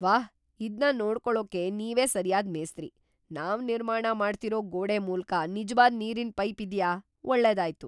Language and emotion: Kannada, surprised